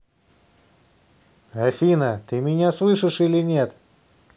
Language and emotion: Russian, angry